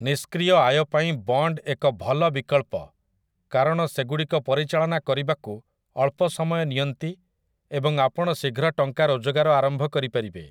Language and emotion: Odia, neutral